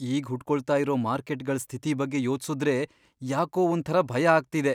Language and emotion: Kannada, fearful